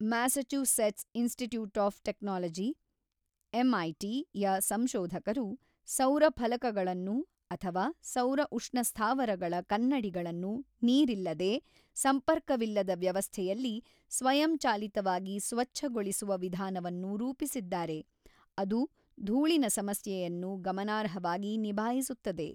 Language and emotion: Kannada, neutral